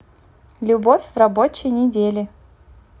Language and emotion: Russian, positive